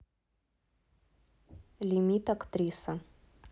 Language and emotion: Russian, neutral